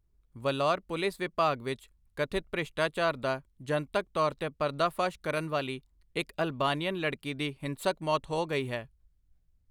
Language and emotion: Punjabi, neutral